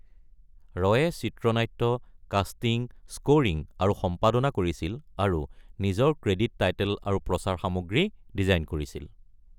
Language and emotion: Assamese, neutral